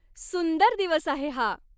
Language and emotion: Marathi, happy